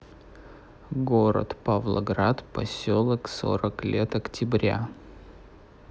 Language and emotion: Russian, neutral